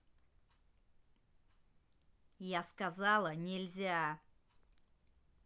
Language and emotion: Russian, angry